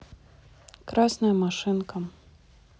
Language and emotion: Russian, neutral